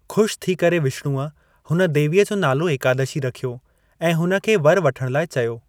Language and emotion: Sindhi, neutral